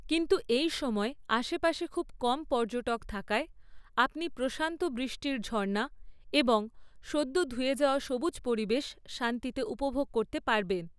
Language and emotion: Bengali, neutral